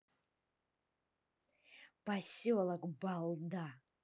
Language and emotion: Russian, angry